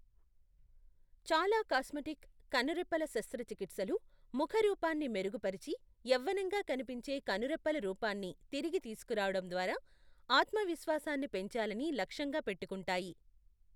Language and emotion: Telugu, neutral